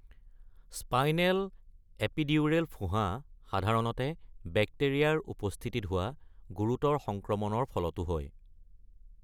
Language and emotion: Assamese, neutral